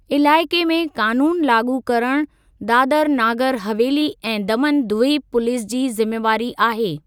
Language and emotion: Sindhi, neutral